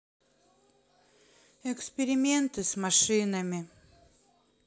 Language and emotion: Russian, sad